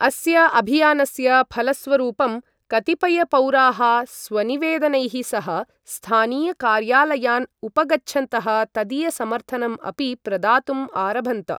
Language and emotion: Sanskrit, neutral